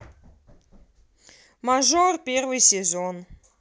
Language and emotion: Russian, neutral